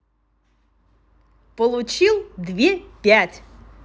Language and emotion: Russian, positive